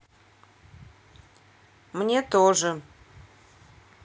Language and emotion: Russian, neutral